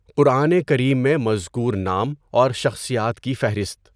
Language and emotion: Urdu, neutral